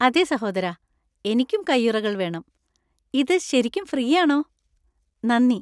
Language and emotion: Malayalam, happy